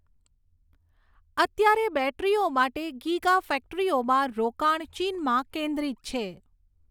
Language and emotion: Gujarati, neutral